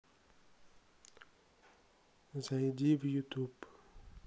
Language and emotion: Russian, neutral